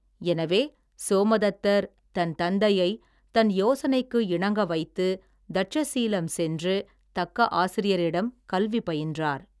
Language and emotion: Tamil, neutral